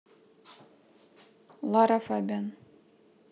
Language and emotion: Russian, neutral